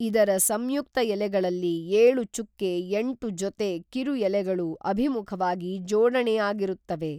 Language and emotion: Kannada, neutral